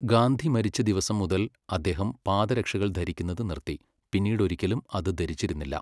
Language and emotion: Malayalam, neutral